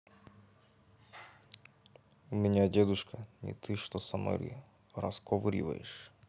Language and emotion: Russian, neutral